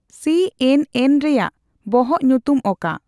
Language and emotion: Santali, neutral